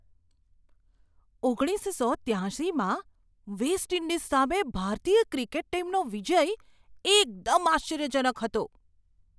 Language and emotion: Gujarati, surprised